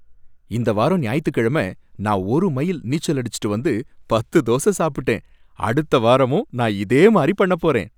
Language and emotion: Tamil, happy